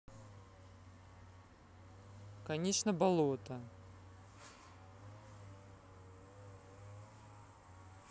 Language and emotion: Russian, neutral